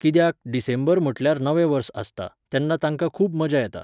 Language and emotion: Goan Konkani, neutral